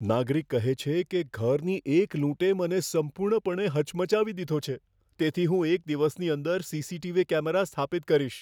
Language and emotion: Gujarati, fearful